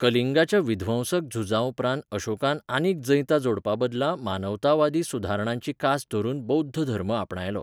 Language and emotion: Goan Konkani, neutral